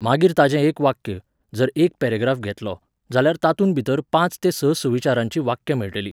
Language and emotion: Goan Konkani, neutral